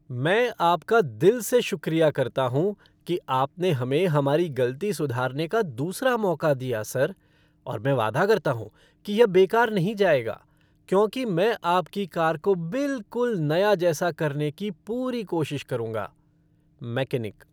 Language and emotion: Hindi, happy